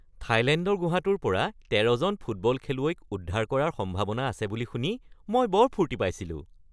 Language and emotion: Assamese, happy